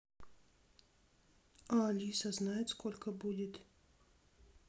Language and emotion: Russian, neutral